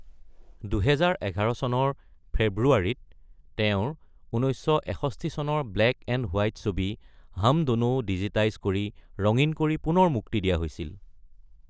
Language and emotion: Assamese, neutral